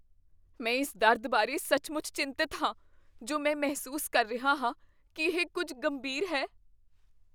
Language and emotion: Punjabi, fearful